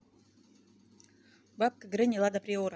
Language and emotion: Russian, neutral